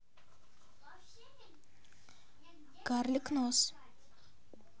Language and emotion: Russian, neutral